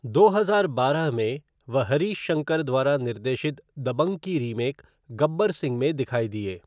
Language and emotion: Hindi, neutral